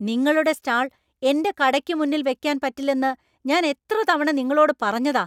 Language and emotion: Malayalam, angry